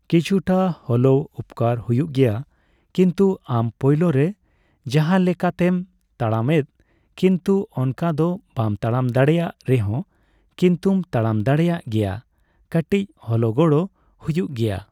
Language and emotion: Santali, neutral